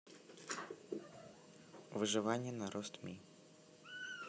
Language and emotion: Russian, neutral